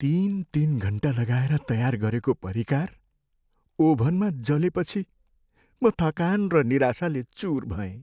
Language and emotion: Nepali, sad